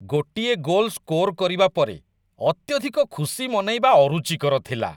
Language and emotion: Odia, disgusted